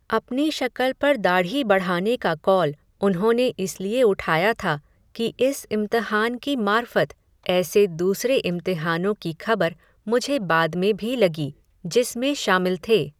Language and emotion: Hindi, neutral